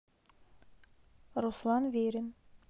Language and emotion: Russian, neutral